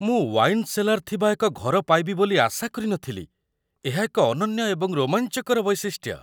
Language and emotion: Odia, surprised